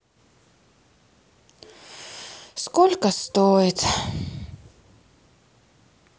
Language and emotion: Russian, sad